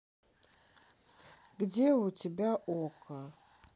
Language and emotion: Russian, neutral